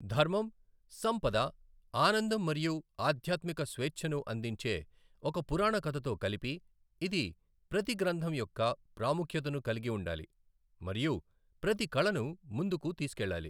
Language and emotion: Telugu, neutral